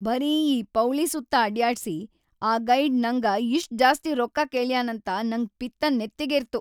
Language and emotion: Kannada, angry